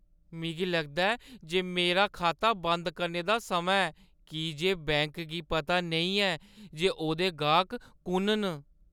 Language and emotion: Dogri, sad